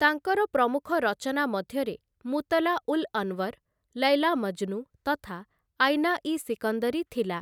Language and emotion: Odia, neutral